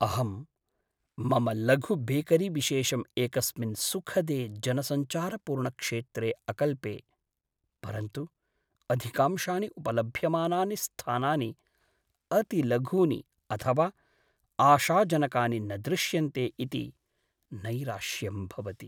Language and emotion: Sanskrit, sad